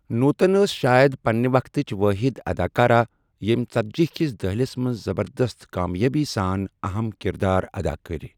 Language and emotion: Kashmiri, neutral